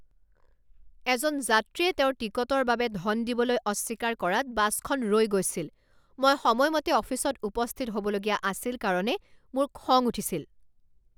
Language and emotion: Assamese, angry